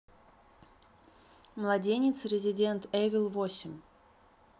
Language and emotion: Russian, neutral